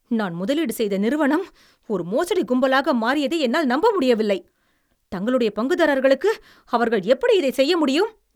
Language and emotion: Tamil, angry